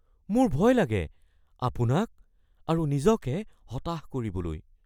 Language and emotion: Assamese, fearful